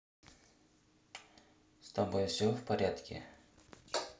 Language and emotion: Russian, neutral